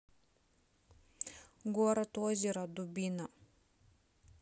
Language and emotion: Russian, neutral